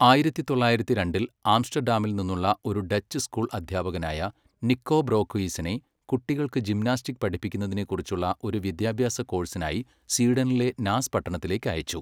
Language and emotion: Malayalam, neutral